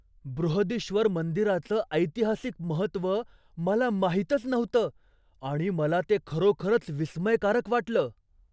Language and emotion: Marathi, surprised